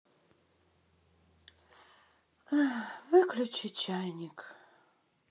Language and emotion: Russian, sad